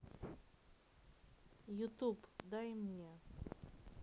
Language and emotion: Russian, neutral